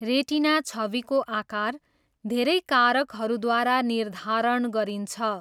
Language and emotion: Nepali, neutral